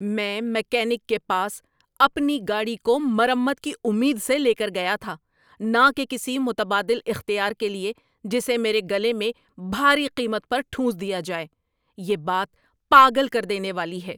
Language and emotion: Urdu, angry